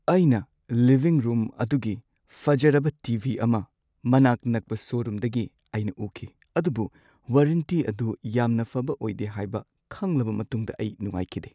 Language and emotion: Manipuri, sad